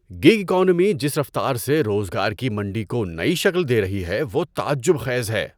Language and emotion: Urdu, surprised